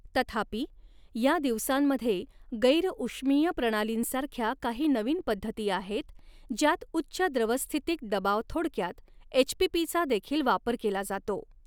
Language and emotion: Marathi, neutral